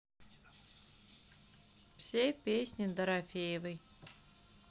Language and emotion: Russian, neutral